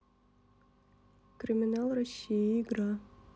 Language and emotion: Russian, neutral